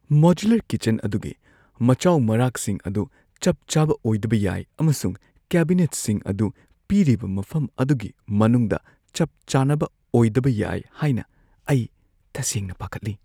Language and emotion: Manipuri, fearful